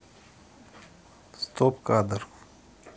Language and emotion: Russian, neutral